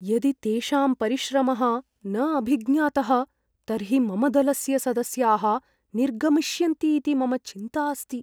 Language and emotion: Sanskrit, fearful